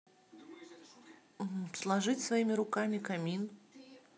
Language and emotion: Russian, neutral